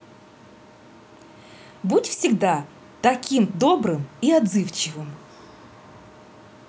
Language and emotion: Russian, positive